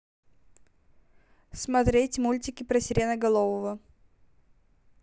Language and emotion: Russian, neutral